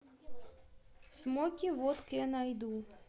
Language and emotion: Russian, neutral